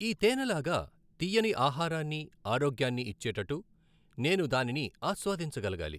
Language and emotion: Telugu, neutral